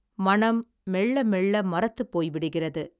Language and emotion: Tamil, neutral